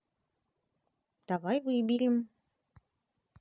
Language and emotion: Russian, positive